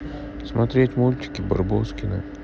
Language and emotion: Russian, sad